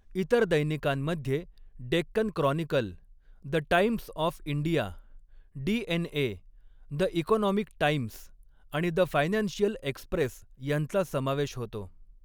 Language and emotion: Marathi, neutral